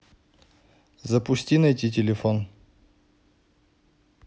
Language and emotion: Russian, neutral